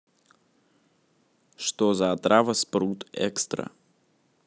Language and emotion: Russian, neutral